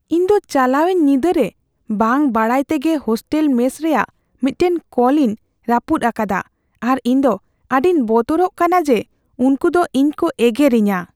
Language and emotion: Santali, fearful